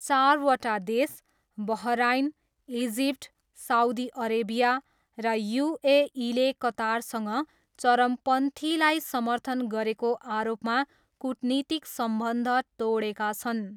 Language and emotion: Nepali, neutral